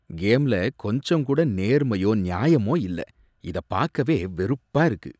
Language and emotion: Tamil, disgusted